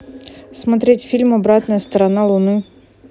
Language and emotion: Russian, neutral